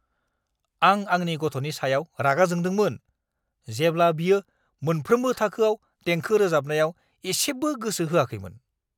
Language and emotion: Bodo, angry